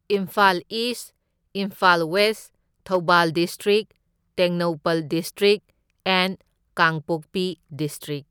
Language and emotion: Manipuri, neutral